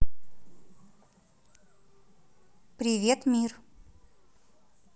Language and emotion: Russian, neutral